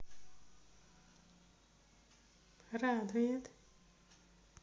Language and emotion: Russian, neutral